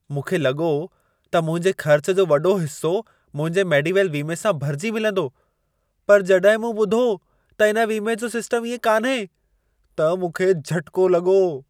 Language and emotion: Sindhi, surprised